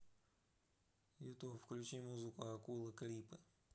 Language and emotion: Russian, neutral